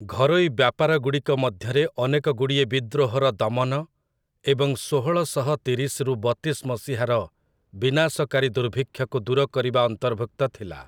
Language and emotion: Odia, neutral